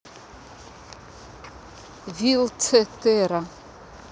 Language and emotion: Russian, neutral